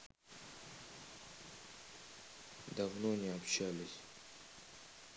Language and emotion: Russian, sad